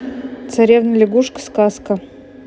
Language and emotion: Russian, neutral